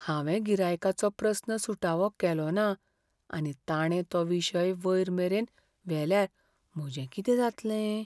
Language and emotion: Goan Konkani, fearful